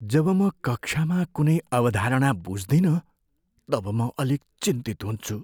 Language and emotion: Nepali, fearful